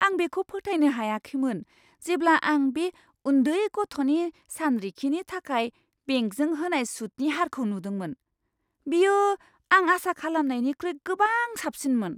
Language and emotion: Bodo, surprised